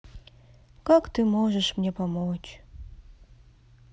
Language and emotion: Russian, sad